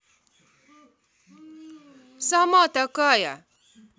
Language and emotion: Russian, angry